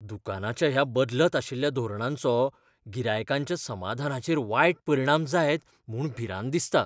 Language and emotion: Goan Konkani, fearful